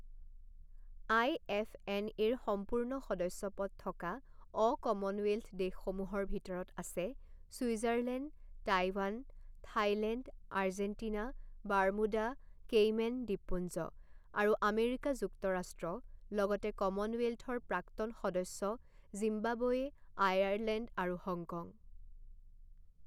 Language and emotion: Assamese, neutral